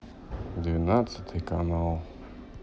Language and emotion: Russian, sad